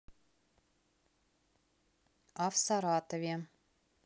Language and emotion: Russian, neutral